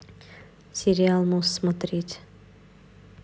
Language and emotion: Russian, neutral